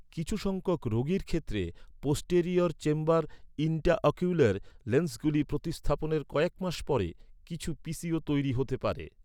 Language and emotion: Bengali, neutral